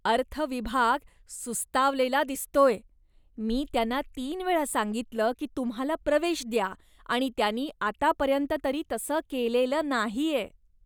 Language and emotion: Marathi, disgusted